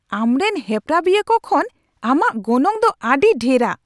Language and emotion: Santali, angry